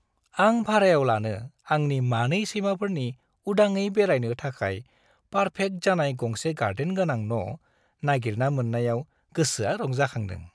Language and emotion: Bodo, happy